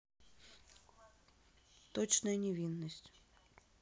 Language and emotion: Russian, neutral